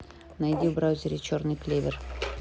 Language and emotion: Russian, neutral